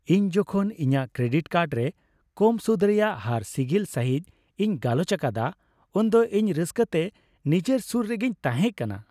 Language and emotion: Santali, happy